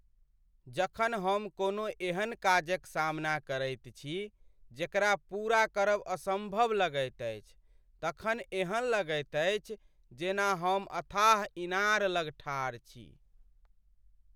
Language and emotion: Maithili, sad